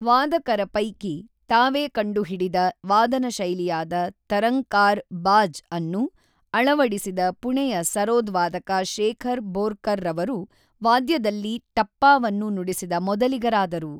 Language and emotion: Kannada, neutral